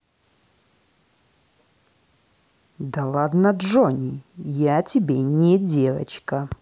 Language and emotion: Russian, angry